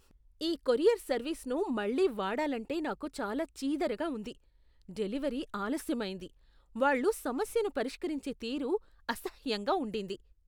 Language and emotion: Telugu, disgusted